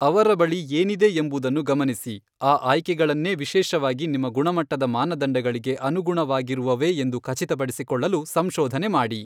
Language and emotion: Kannada, neutral